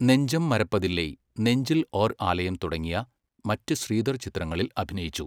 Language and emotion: Malayalam, neutral